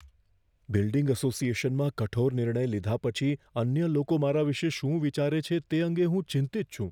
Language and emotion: Gujarati, fearful